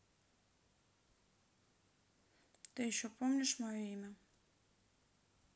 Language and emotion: Russian, sad